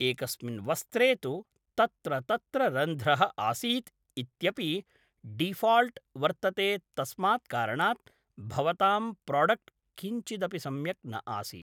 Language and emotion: Sanskrit, neutral